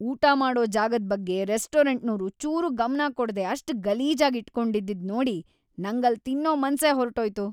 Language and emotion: Kannada, disgusted